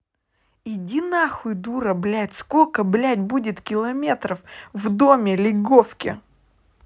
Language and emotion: Russian, angry